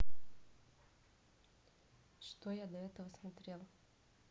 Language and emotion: Russian, neutral